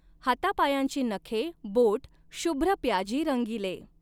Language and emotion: Marathi, neutral